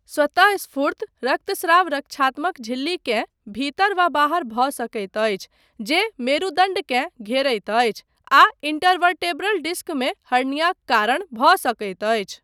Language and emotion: Maithili, neutral